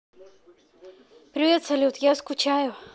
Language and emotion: Russian, neutral